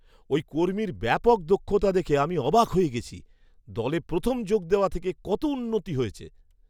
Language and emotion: Bengali, surprised